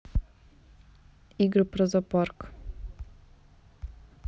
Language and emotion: Russian, neutral